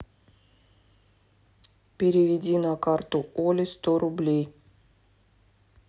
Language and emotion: Russian, neutral